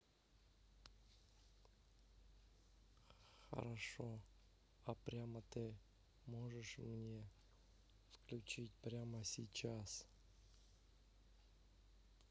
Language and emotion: Russian, neutral